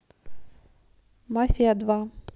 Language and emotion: Russian, neutral